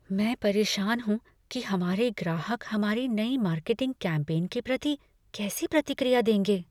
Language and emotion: Hindi, fearful